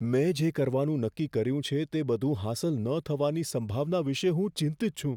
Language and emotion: Gujarati, fearful